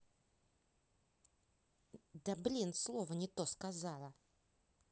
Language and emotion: Russian, angry